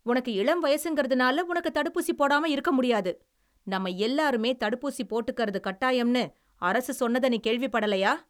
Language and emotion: Tamil, angry